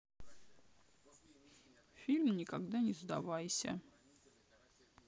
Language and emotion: Russian, sad